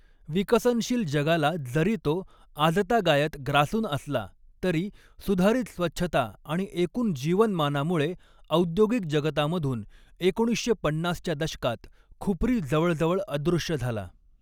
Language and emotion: Marathi, neutral